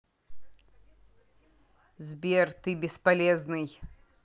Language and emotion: Russian, angry